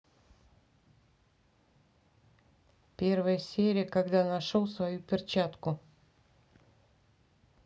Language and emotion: Russian, neutral